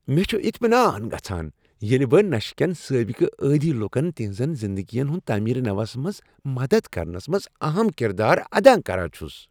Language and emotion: Kashmiri, happy